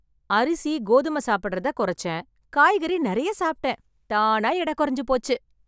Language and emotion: Tamil, happy